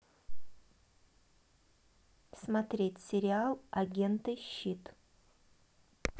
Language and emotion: Russian, neutral